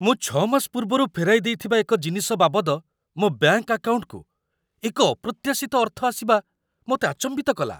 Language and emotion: Odia, surprised